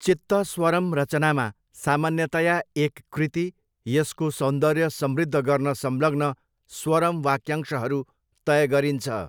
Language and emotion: Nepali, neutral